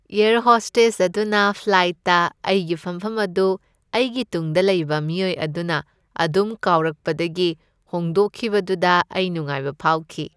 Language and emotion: Manipuri, happy